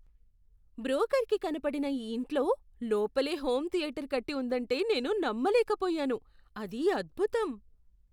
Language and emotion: Telugu, surprised